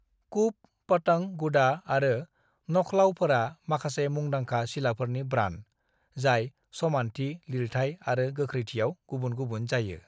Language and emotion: Bodo, neutral